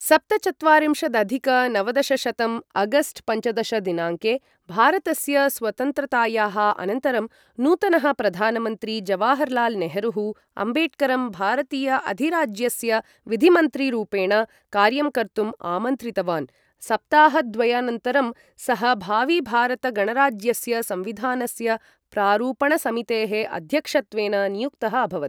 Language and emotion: Sanskrit, neutral